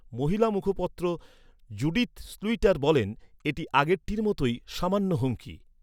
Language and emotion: Bengali, neutral